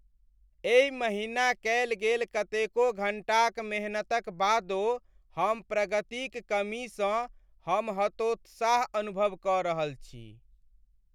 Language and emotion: Maithili, sad